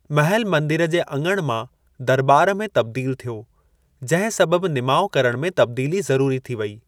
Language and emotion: Sindhi, neutral